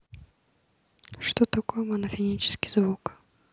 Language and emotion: Russian, neutral